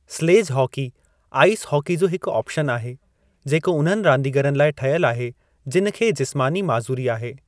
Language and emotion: Sindhi, neutral